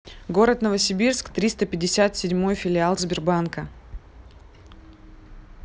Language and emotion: Russian, neutral